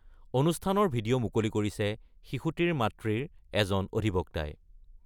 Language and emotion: Assamese, neutral